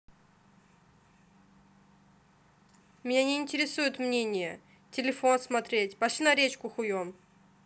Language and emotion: Russian, angry